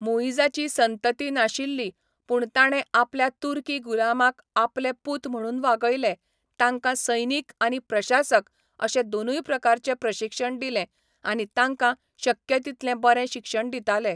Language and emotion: Goan Konkani, neutral